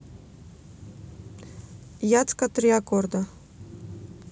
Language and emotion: Russian, neutral